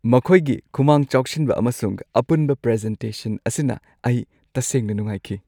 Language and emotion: Manipuri, happy